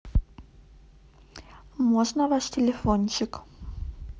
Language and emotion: Russian, neutral